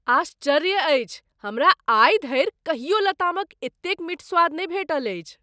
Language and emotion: Maithili, surprised